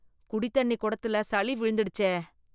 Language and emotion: Tamil, disgusted